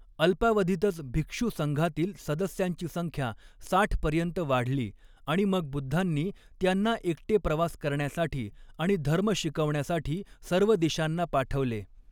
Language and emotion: Marathi, neutral